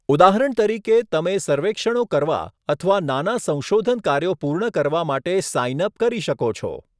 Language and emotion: Gujarati, neutral